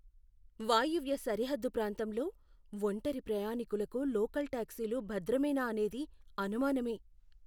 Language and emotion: Telugu, fearful